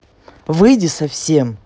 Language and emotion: Russian, angry